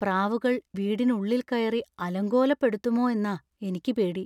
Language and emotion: Malayalam, fearful